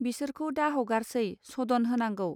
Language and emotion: Bodo, neutral